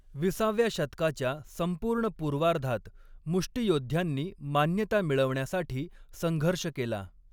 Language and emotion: Marathi, neutral